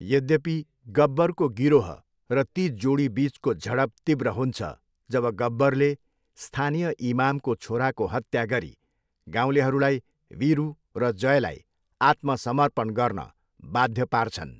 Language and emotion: Nepali, neutral